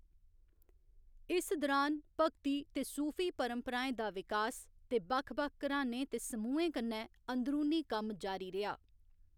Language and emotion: Dogri, neutral